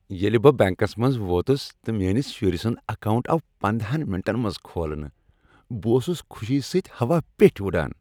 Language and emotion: Kashmiri, happy